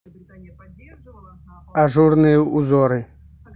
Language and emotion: Russian, neutral